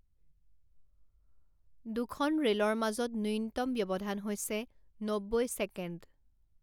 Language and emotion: Assamese, neutral